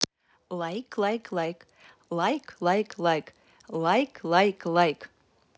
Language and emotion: Russian, positive